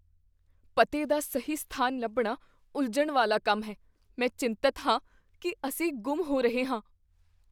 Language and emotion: Punjabi, fearful